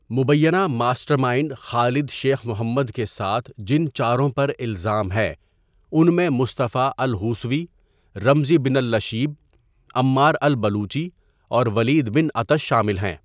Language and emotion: Urdu, neutral